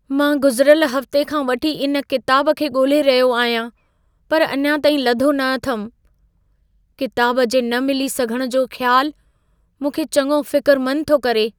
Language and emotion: Sindhi, fearful